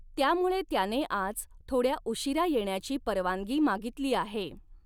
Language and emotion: Marathi, neutral